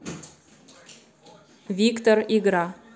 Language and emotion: Russian, neutral